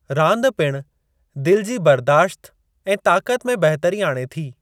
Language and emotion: Sindhi, neutral